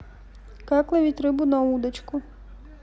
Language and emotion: Russian, neutral